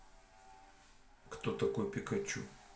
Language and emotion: Russian, neutral